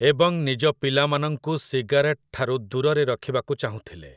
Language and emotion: Odia, neutral